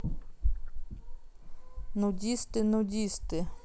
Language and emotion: Russian, neutral